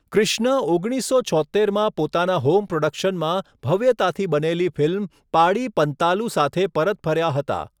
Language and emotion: Gujarati, neutral